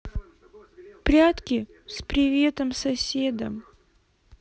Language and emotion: Russian, sad